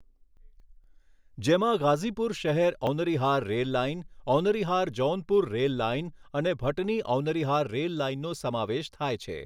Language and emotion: Gujarati, neutral